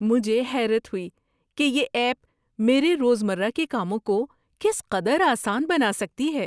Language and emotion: Urdu, surprised